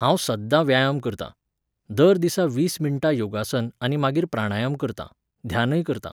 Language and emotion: Goan Konkani, neutral